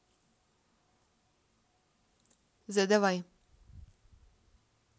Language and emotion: Russian, neutral